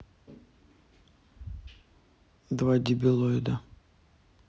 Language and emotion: Russian, neutral